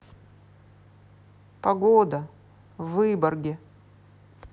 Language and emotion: Russian, neutral